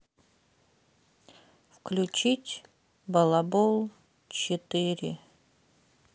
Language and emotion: Russian, sad